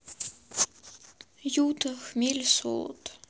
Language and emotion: Russian, sad